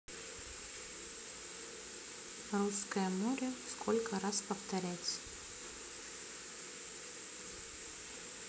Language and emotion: Russian, neutral